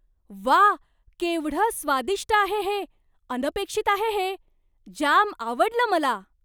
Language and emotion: Marathi, surprised